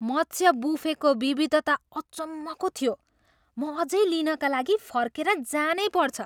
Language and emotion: Nepali, surprised